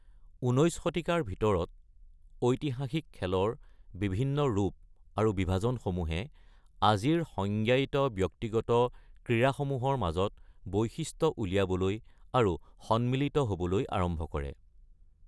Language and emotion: Assamese, neutral